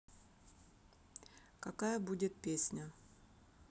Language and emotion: Russian, neutral